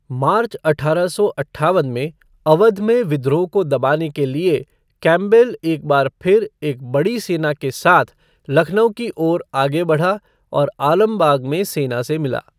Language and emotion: Hindi, neutral